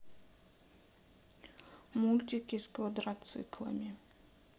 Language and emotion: Russian, neutral